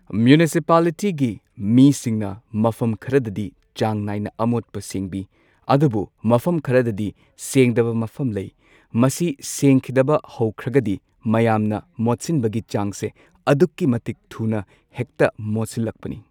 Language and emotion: Manipuri, neutral